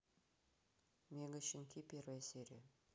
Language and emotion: Russian, neutral